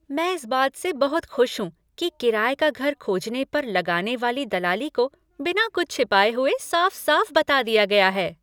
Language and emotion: Hindi, happy